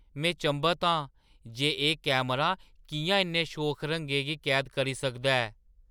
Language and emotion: Dogri, surprised